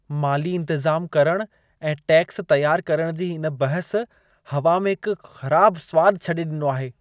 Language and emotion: Sindhi, disgusted